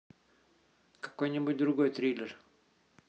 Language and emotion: Russian, neutral